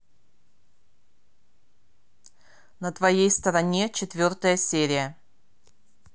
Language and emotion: Russian, neutral